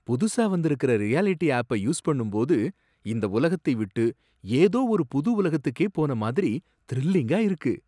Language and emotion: Tamil, surprised